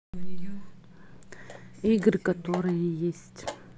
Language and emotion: Russian, neutral